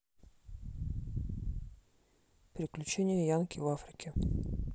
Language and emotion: Russian, neutral